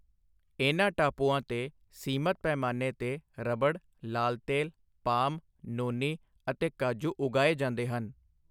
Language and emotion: Punjabi, neutral